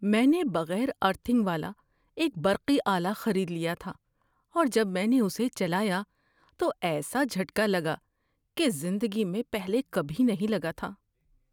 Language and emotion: Urdu, fearful